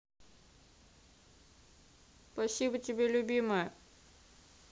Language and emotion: Russian, positive